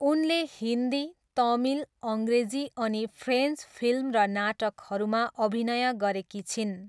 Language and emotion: Nepali, neutral